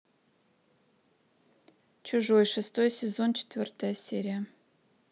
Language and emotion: Russian, neutral